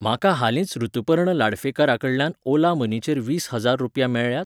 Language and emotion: Goan Konkani, neutral